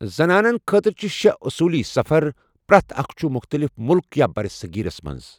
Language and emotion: Kashmiri, neutral